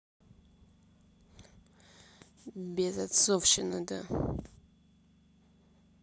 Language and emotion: Russian, neutral